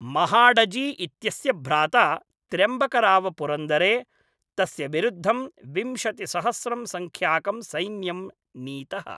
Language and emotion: Sanskrit, neutral